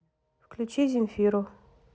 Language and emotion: Russian, neutral